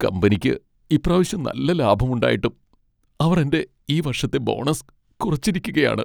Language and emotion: Malayalam, sad